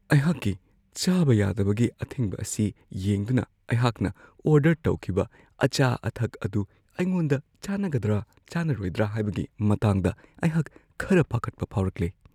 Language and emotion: Manipuri, fearful